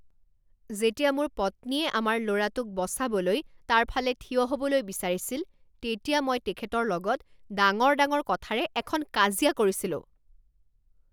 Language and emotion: Assamese, angry